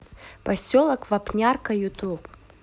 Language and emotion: Russian, neutral